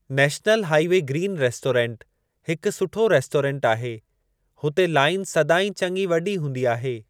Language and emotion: Sindhi, neutral